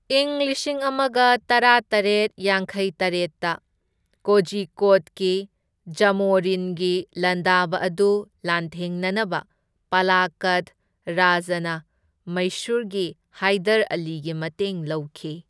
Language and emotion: Manipuri, neutral